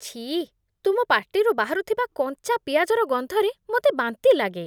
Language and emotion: Odia, disgusted